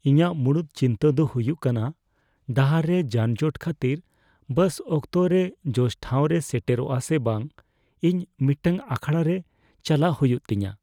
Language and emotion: Santali, fearful